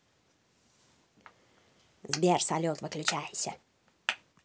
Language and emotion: Russian, angry